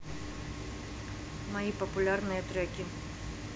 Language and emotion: Russian, neutral